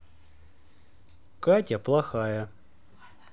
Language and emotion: Russian, neutral